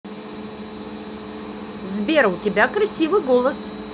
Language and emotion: Russian, positive